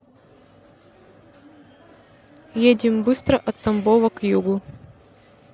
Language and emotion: Russian, neutral